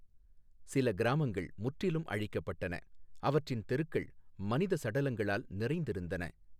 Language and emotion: Tamil, neutral